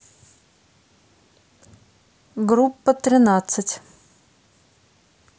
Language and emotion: Russian, neutral